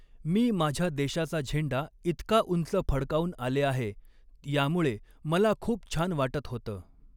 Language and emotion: Marathi, neutral